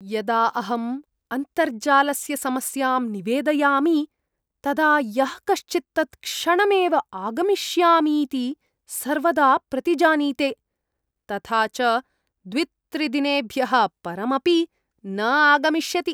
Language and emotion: Sanskrit, disgusted